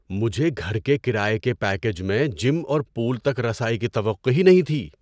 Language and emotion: Urdu, surprised